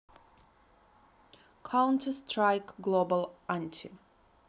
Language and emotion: Russian, neutral